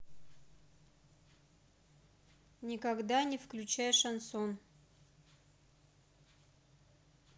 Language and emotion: Russian, neutral